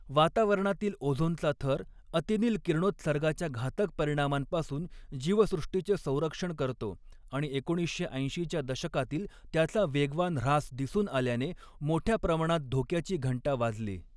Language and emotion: Marathi, neutral